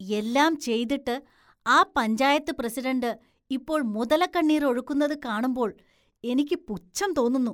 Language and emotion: Malayalam, disgusted